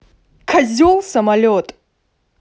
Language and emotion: Russian, angry